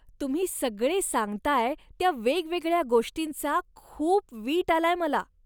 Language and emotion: Marathi, disgusted